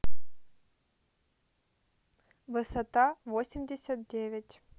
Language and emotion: Russian, neutral